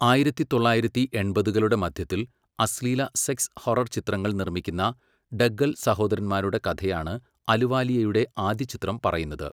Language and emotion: Malayalam, neutral